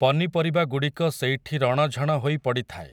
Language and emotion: Odia, neutral